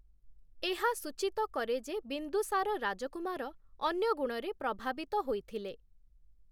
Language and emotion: Odia, neutral